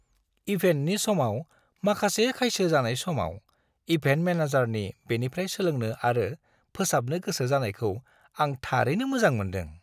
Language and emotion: Bodo, happy